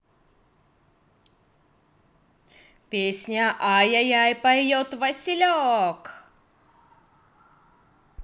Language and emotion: Russian, positive